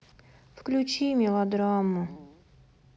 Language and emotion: Russian, sad